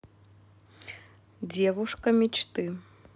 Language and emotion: Russian, neutral